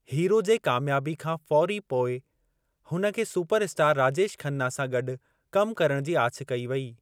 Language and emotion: Sindhi, neutral